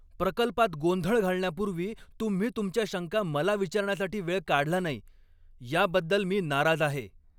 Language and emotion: Marathi, angry